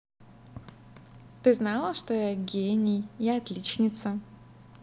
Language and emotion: Russian, positive